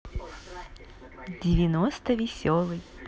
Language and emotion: Russian, positive